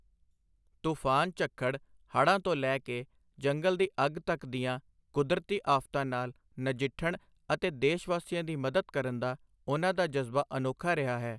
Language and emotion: Punjabi, neutral